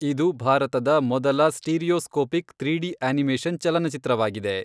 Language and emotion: Kannada, neutral